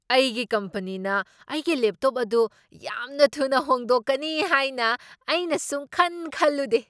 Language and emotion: Manipuri, surprised